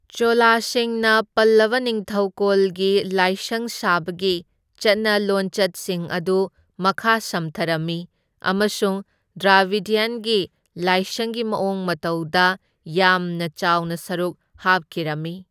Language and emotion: Manipuri, neutral